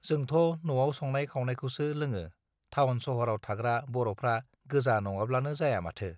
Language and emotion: Bodo, neutral